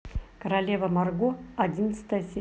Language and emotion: Russian, neutral